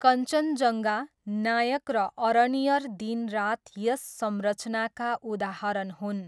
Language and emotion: Nepali, neutral